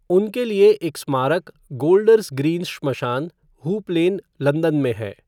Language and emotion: Hindi, neutral